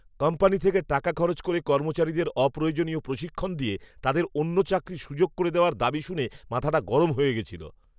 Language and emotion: Bengali, angry